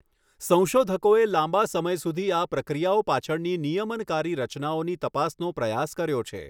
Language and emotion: Gujarati, neutral